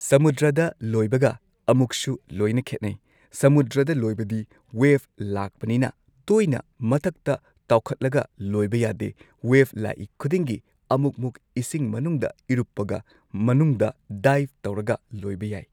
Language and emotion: Manipuri, neutral